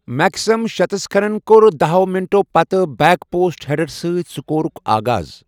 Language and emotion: Kashmiri, neutral